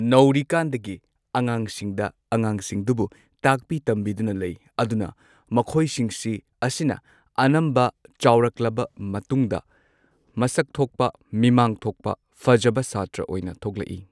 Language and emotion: Manipuri, neutral